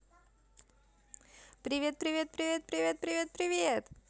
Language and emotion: Russian, positive